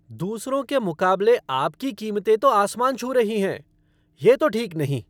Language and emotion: Hindi, angry